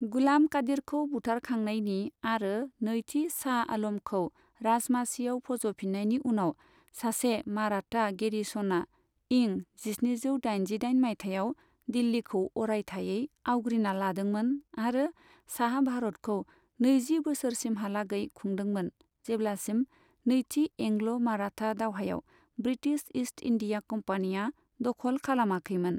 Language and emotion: Bodo, neutral